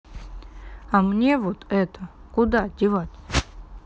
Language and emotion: Russian, neutral